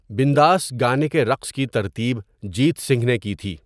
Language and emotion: Urdu, neutral